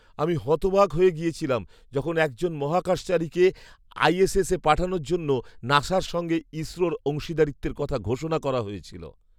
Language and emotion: Bengali, surprised